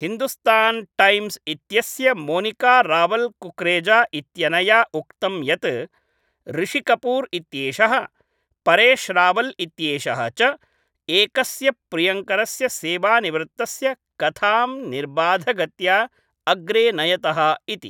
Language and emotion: Sanskrit, neutral